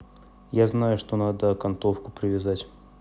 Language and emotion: Russian, neutral